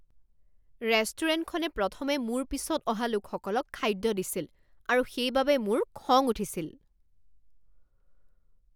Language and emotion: Assamese, angry